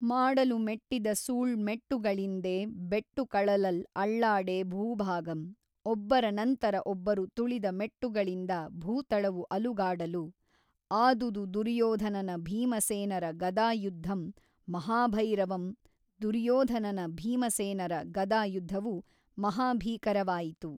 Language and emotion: Kannada, neutral